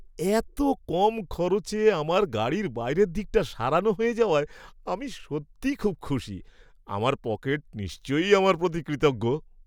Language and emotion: Bengali, happy